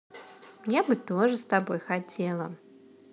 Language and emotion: Russian, positive